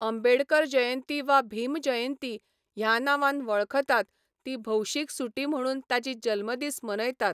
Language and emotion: Goan Konkani, neutral